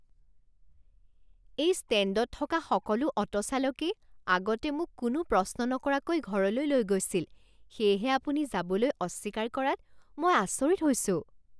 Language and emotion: Assamese, surprised